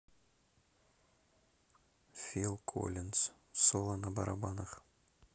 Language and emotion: Russian, neutral